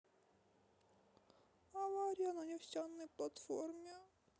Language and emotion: Russian, sad